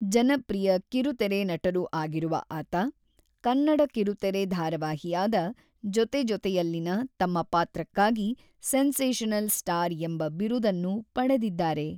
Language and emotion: Kannada, neutral